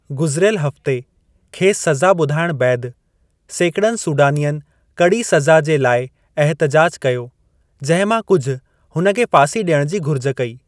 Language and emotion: Sindhi, neutral